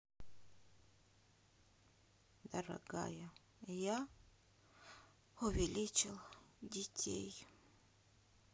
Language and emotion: Russian, sad